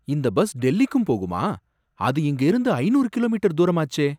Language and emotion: Tamil, surprised